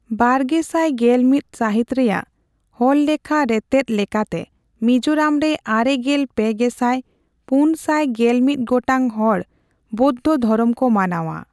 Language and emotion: Santali, neutral